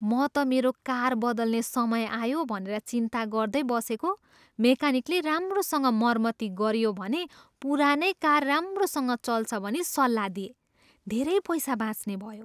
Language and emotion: Nepali, surprised